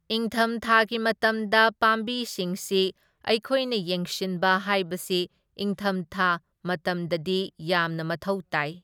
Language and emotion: Manipuri, neutral